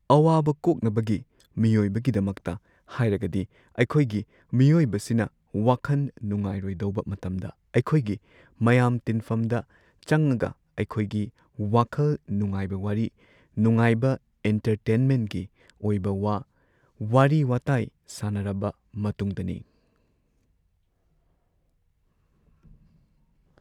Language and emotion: Manipuri, neutral